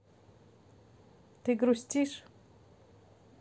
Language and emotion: Russian, neutral